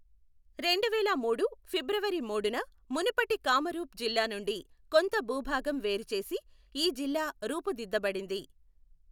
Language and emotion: Telugu, neutral